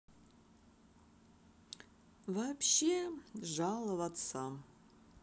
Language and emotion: Russian, sad